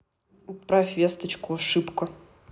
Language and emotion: Russian, neutral